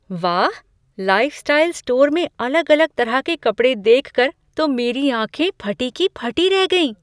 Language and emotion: Hindi, surprised